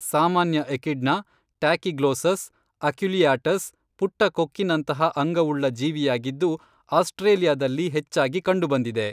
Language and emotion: Kannada, neutral